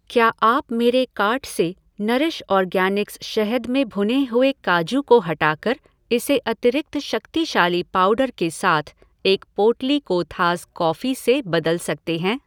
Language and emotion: Hindi, neutral